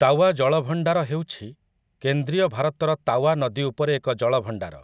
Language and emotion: Odia, neutral